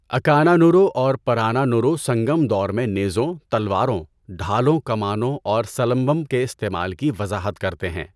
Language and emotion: Urdu, neutral